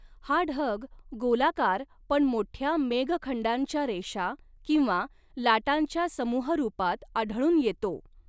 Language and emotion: Marathi, neutral